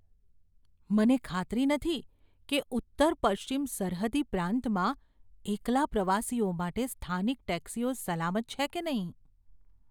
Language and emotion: Gujarati, fearful